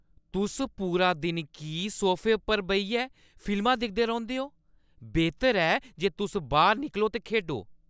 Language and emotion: Dogri, angry